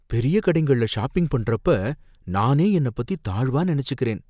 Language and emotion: Tamil, fearful